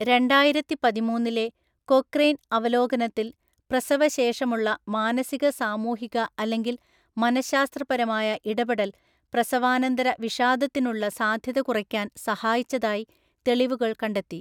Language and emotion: Malayalam, neutral